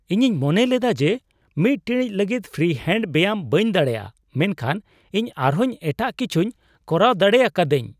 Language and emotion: Santali, surprised